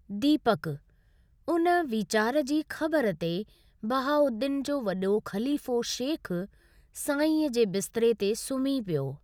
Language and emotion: Sindhi, neutral